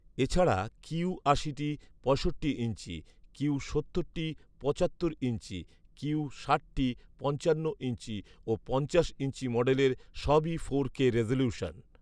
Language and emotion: Bengali, neutral